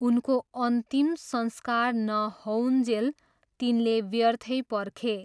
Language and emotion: Nepali, neutral